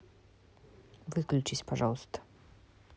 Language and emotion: Russian, neutral